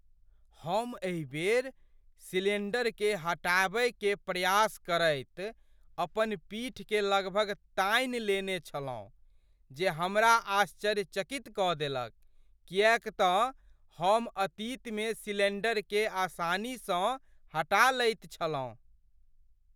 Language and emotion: Maithili, surprised